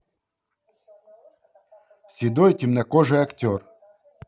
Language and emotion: Russian, positive